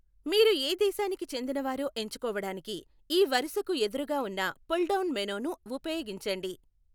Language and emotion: Telugu, neutral